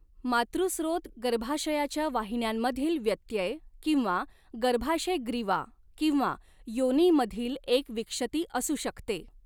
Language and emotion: Marathi, neutral